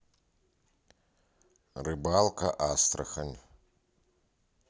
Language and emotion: Russian, neutral